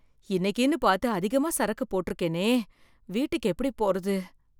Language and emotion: Tamil, fearful